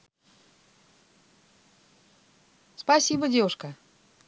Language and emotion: Russian, positive